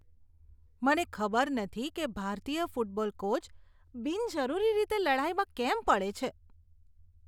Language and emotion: Gujarati, disgusted